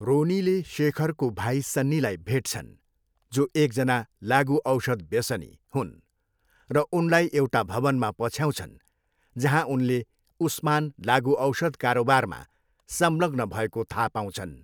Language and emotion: Nepali, neutral